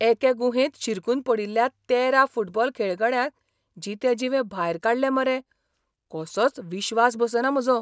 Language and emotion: Goan Konkani, surprised